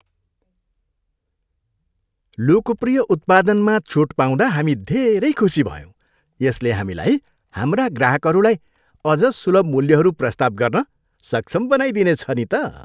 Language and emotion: Nepali, happy